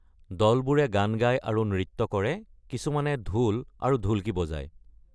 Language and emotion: Assamese, neutral